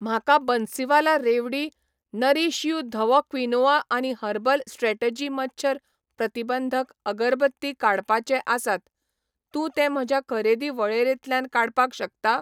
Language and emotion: Goan Konkani, neutral